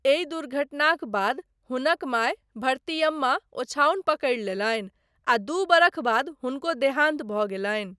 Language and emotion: Maithili, neutral